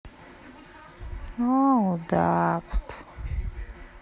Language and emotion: Russian, sad